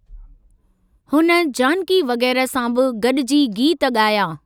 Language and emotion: Sindhi, neutral